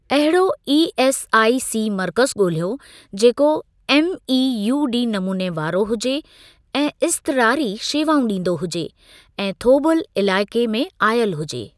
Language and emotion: Sindhi, neutral